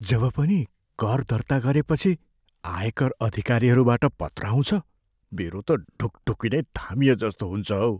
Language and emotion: Nepali, fearful